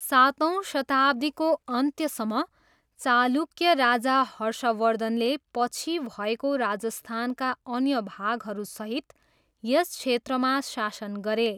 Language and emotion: Nepali, neutral